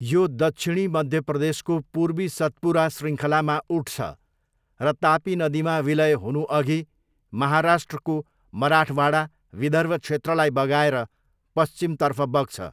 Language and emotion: Nepali, neutral